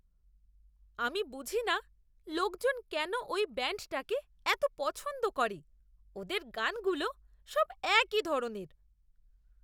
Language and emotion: Bengali, disgusted